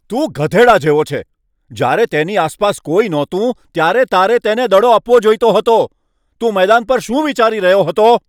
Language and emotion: Gujarati, angry